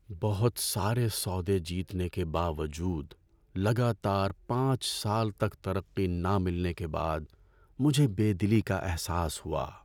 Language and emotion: Urdu, sad